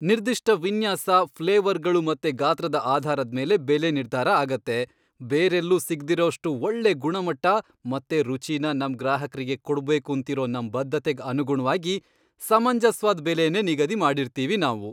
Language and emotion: Kannada, happy